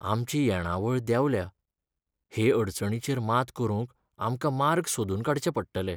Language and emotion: Goan Konkani, sad